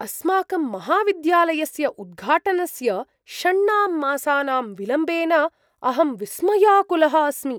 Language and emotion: Sanskrit, surprised